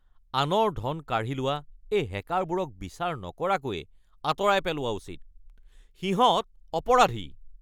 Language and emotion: Assamese, angry